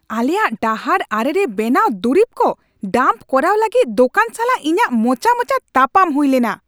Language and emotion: Santali, angry